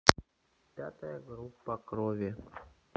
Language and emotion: Russian, neutral